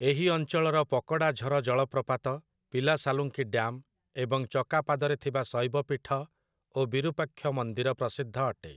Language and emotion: Odia, neutral